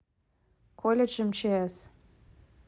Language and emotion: Russian, neutral